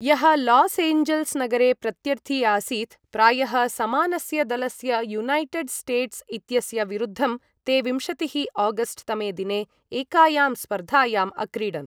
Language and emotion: Sanskrit, neutral